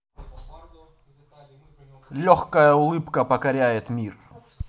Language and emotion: Russian, positive